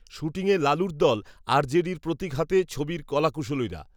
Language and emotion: Bengali, neutral